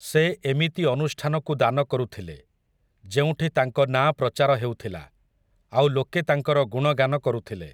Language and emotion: Odia, neutral